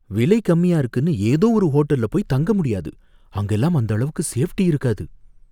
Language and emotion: Tamil, fearful